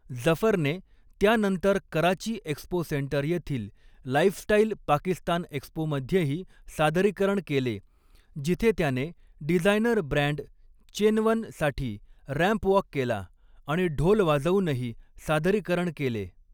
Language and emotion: Marathi, neutral